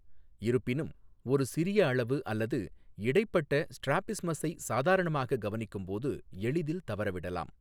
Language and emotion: Tamil, neutral